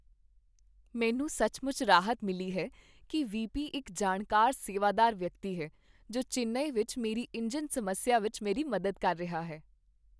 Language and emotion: Punjabi, happy